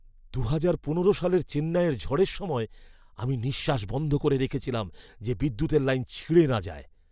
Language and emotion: Bengali, fearful